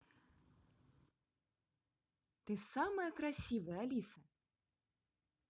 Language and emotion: Russian, positive